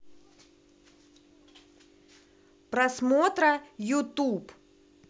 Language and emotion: Russian, neutral